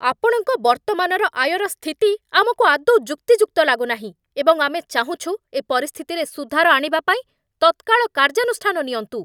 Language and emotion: Odia, angry